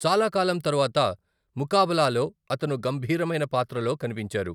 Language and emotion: Telugu, neutral